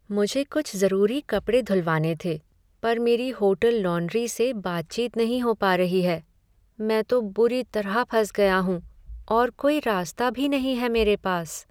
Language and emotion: Hindi, sad